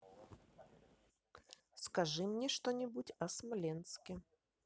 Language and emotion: Russian, neutral